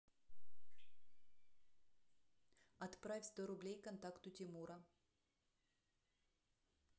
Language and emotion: Russian, neutral